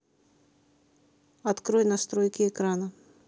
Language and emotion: Russian, neutral